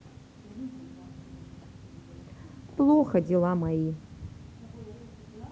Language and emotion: Russian, neutral